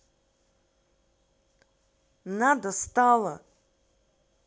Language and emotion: Russian, angry